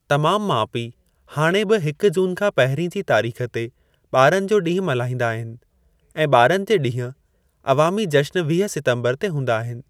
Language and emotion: Sindhi, neutral